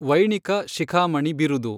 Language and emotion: Kannada, neutral